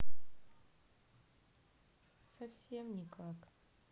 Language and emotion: Russian, sad